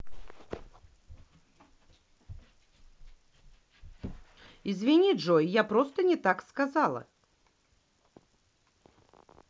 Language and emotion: Russian, neutral